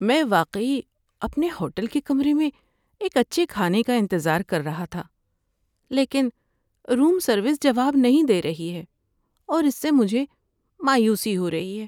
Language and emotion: Urdu, sad